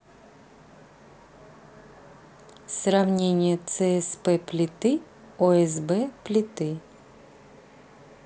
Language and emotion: Russian, neutral